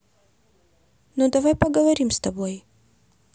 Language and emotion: Russian, positive